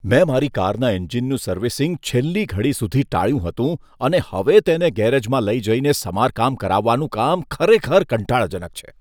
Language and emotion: Gujarati, disgusted